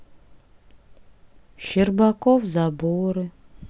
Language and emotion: Russian, sad